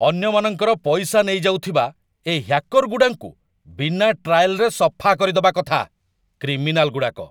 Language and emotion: Odia, angry